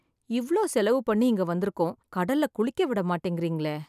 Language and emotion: Tamil, sad